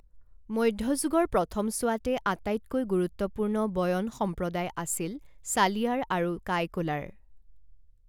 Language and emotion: Assamese, neutral